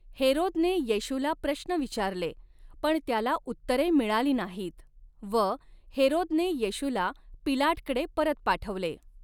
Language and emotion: Marathi, neutral